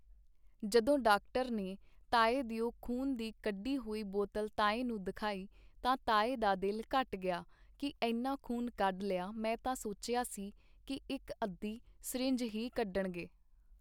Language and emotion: Punjabi, neutral